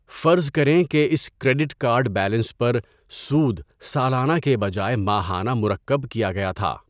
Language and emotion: Urdu, neutral